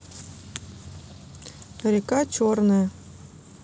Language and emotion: Russian, neutral